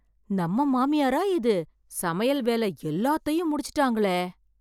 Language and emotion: Tamil, surprised